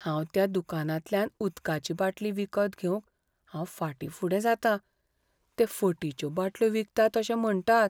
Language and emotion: Goan Konkani, fearful